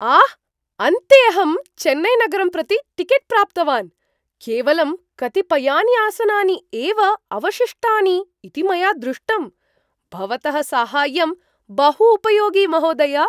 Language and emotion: Sanskrit, surprised